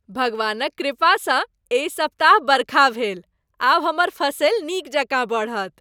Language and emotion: Maithili, happy